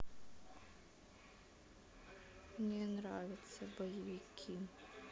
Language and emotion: Russian, sad